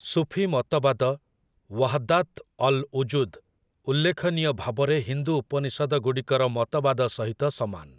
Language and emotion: Odia, neutral